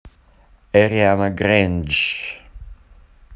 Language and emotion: Russian, neutral